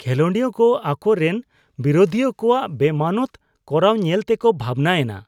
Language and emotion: Santali, disgusted